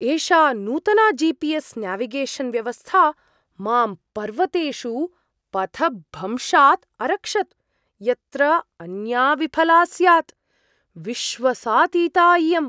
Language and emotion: Sanskrit, surprised